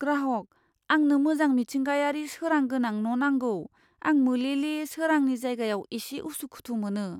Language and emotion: Bodo, fearful